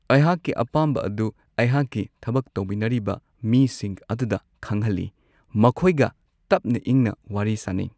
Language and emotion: Manipuri, neutral